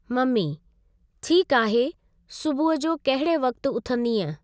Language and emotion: Sindhi, neutral